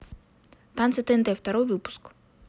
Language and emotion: Russian, neutral